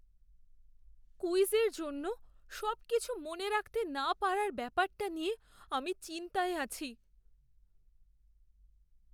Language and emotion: Bengali, fearful